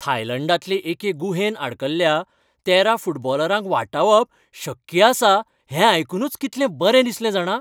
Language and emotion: Goan Konkani, happy